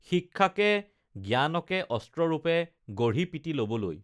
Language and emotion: Assamese, neutral